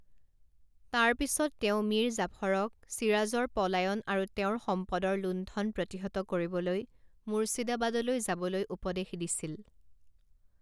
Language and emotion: Assamese, neutral